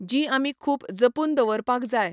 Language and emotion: Goan Konkani, neutral